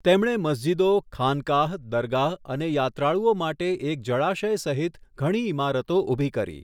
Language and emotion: Gujarati, neutral